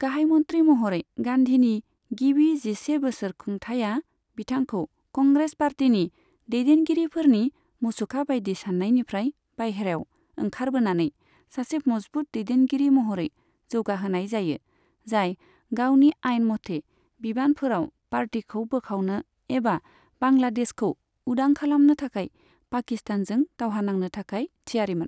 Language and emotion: Bodo, neutral